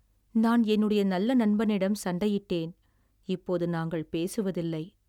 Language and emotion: Tamil, sad